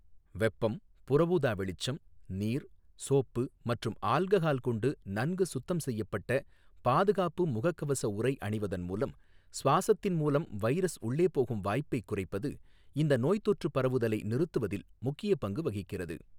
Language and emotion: Tamil, neutral